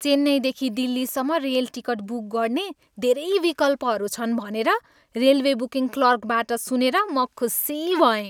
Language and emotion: Nepali, happy